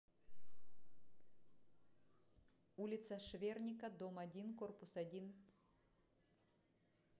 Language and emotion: Russian, neutral